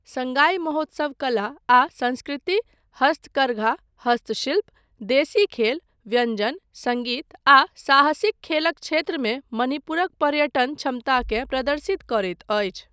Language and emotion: Maithili, neutral